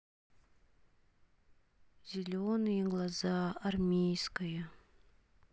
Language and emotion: Russian, sad